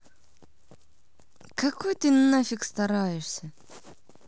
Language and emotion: Russian, angry